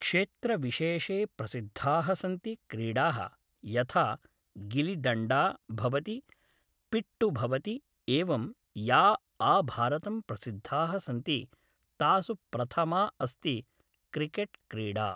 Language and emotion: Sanskrit, neutral